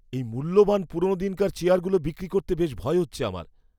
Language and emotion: Bengali, fearful